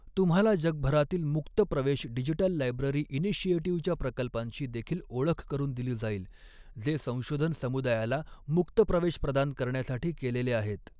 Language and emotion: Marathi, neutral